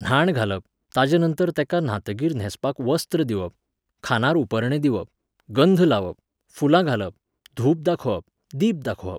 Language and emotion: Goan Konkani, neutral